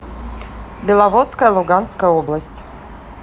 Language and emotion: Russian, neutral